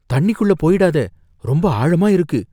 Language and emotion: Tamil, fearful